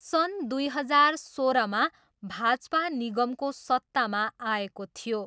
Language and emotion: Nepali, neutral